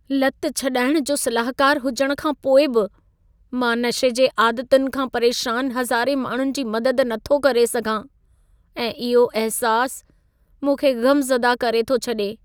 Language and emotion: Sindhi, sad